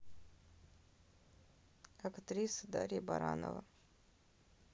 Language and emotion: Russian, neutral